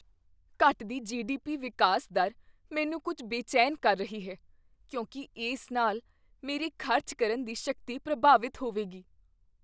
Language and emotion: Punjabi, fearful